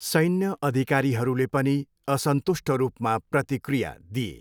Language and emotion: Nepali, neutral